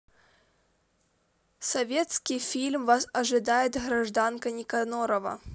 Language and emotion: Russian, neutral